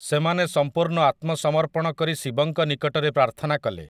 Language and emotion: Odia, neutral